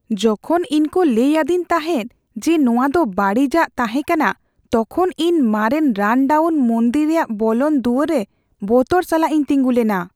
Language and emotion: Santali, fearful